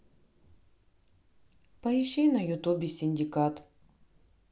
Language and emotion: Russian, neutral